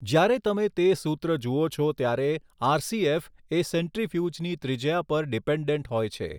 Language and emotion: Gujarati, neutral